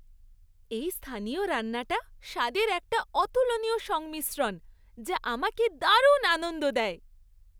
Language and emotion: Bengali, happy